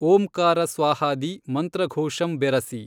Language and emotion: Kannada, neutral